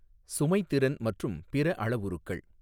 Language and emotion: Tamil, neutral